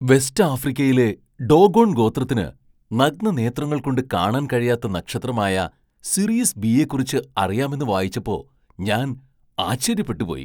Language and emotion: Malayalam, surprised